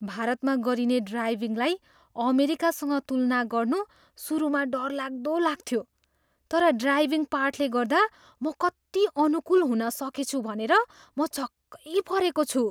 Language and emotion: Nepali, surprised